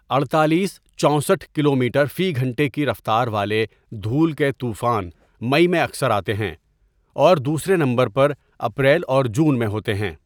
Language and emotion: Urdu, neutral